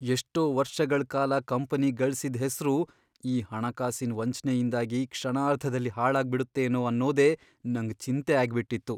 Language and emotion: Kannada, fearful